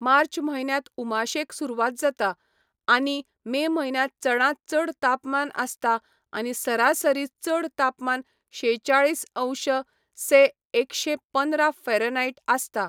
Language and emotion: Goan Konkani, neutral